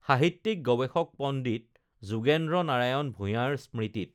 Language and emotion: Assamese, neutral